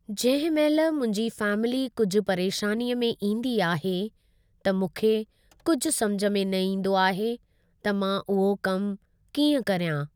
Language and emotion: Sindhi, neutral